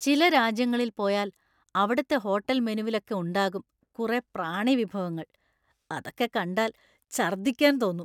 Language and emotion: Malayalam, disgusted